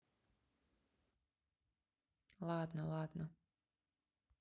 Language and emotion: Russian, neutral